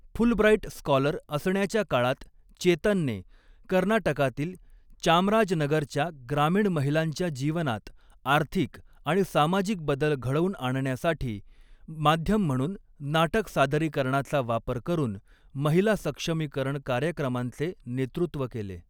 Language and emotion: Marathi, neutral